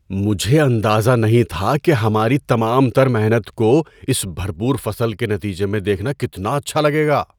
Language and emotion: Urdu, surprised